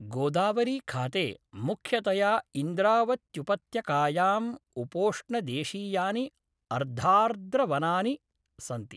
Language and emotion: Sanskrit, neutral